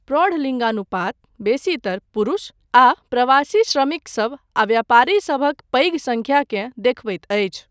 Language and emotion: Maithili, neutral